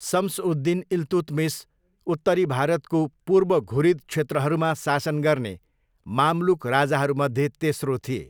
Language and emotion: Nepali, neutral